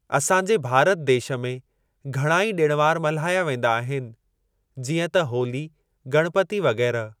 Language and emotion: Sindhi, neutral